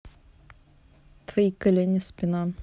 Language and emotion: Russian, neutral